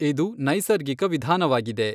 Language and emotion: Kannada, neutral